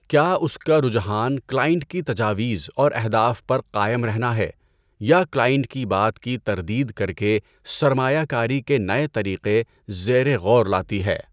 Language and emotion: Urdu, neutral